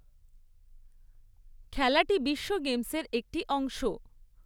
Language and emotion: Bengali, neutral